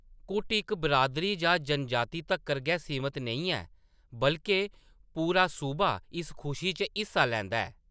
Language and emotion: Dogri, neutral